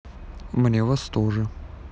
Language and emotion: Russian, neutral